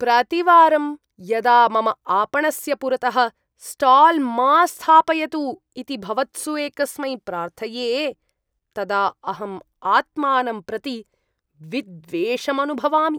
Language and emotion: Sanskrit, disgusted